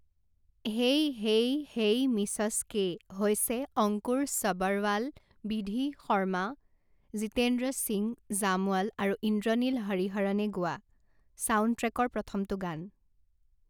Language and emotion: Assamese, neutral